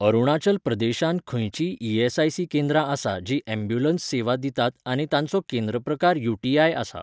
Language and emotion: Goan Konkani, neutral